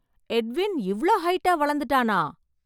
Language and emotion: Tamil, surprised